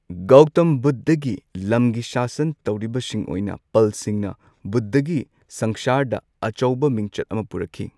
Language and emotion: Manipuri, neutral